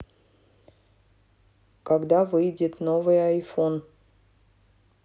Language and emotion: Russian, neutral